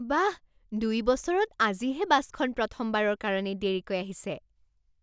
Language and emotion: Assamese, surprised